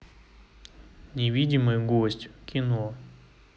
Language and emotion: Russian, neutral